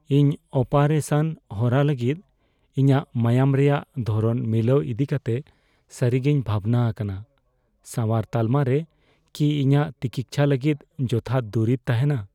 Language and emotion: Santali, fearful